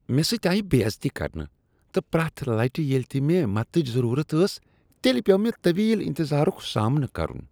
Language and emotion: Kashmiri, disgusted